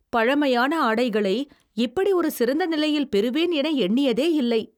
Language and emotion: Tamil, surprised